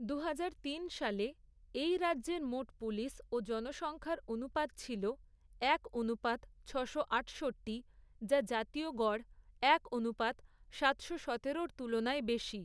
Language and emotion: Bengali, neutral